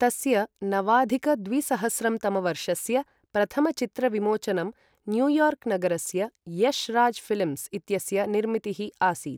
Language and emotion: Sanskrit, neutral